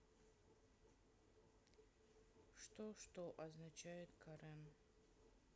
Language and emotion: Russian, sad